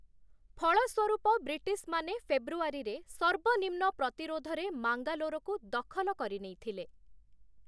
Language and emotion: Odia, neutral